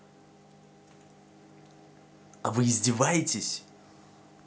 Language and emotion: Russian, angry